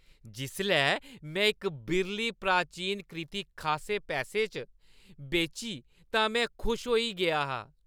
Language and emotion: Dogri, happy